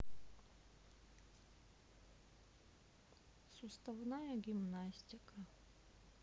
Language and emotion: Russian, neutral